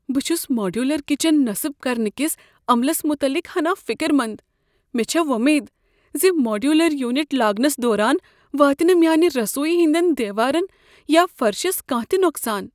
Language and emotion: Kashmiri, fearful